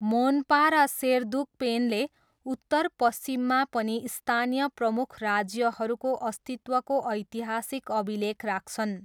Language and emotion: Nepali, neutral